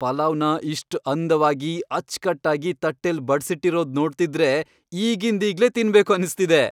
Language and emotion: Kannada, happy